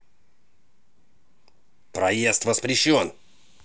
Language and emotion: Russian, angry